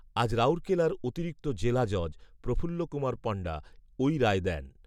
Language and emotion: Bengali, neutral